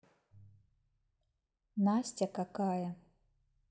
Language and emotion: Russian, neutral